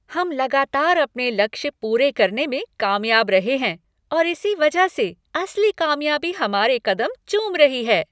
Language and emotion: Hindi, happy